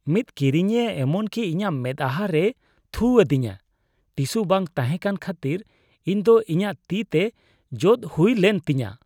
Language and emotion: Santali, disgusted